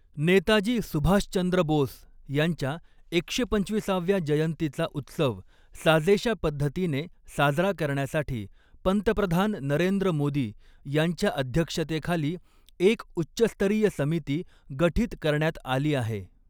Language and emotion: Marathi, neutral